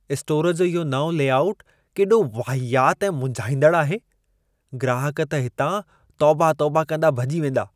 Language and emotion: Sindhi, disgusted